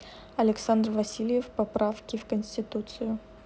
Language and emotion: Russian, neutral